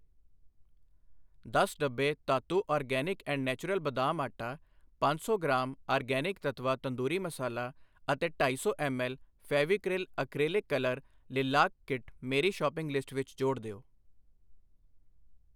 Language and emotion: Punjabi, neutral